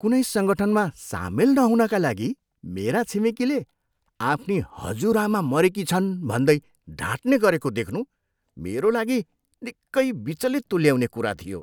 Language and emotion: Nepali, disgusted